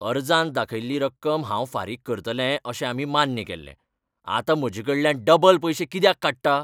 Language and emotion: Goan Konkani, angry